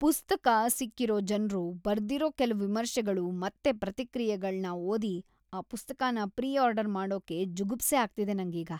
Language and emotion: Kannada, disgusted